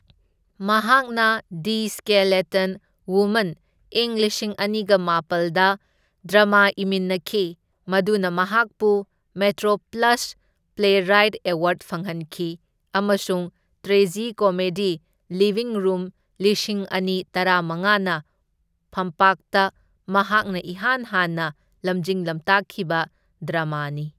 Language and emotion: Manipuri, neutral